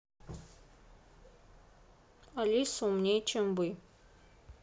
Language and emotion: Russian, neutral